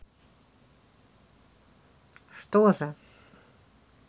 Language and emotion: Russian, neutral